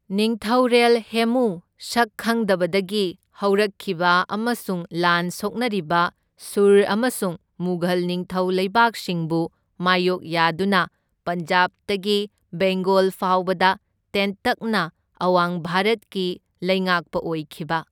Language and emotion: Manipuri, neutral